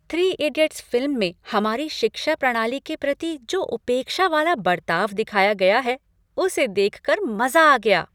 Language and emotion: Hindi, happy